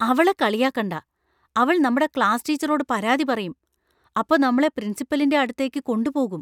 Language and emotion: Malayalam, fearful